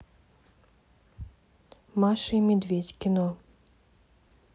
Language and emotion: Russian, neutral